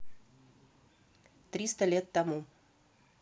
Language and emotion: Russian, neutral